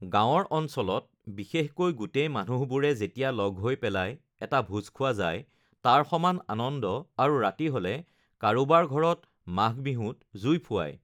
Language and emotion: Assamese, neutral